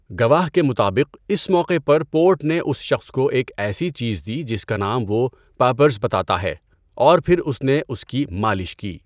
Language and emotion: Urdu, neutral